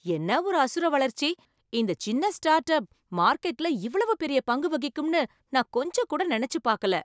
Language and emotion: Tamil, surprised